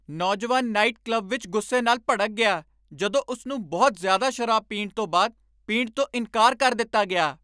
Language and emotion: Punjabi, angry